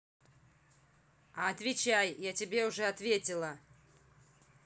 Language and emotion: Russian, angry